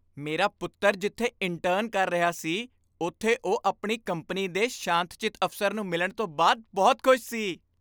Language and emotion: Punjabi, happy